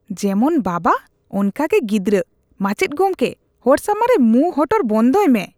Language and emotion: Santali, disgusted